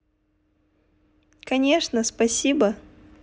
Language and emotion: Russian, positive